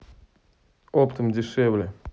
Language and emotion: Russian, neutral